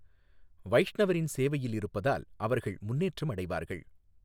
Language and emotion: Tamil, neutral